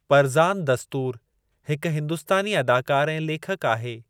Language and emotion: Sindhi, neutral